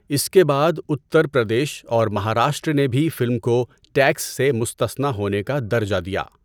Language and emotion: Urdu, neutral